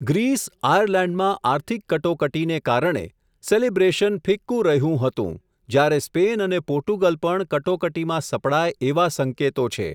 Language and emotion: Gujarati, neutral